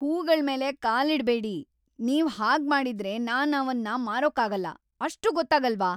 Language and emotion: Kannada, angry